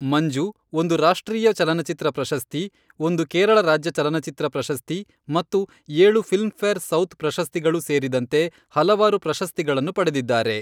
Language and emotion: Kannada, neutral